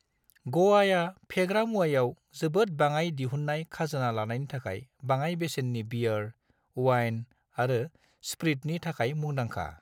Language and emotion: Bodo, neutral